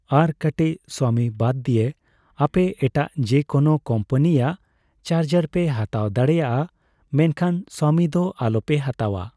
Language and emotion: Santali, neutral